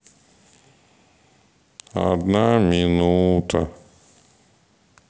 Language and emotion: Russian, sad